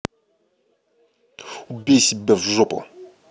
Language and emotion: Russian, angry